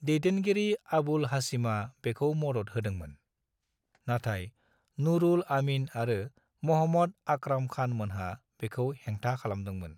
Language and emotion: Bodo, neutral